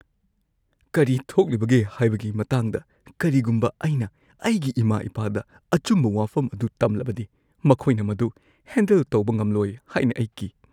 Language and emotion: Manipuri, fearful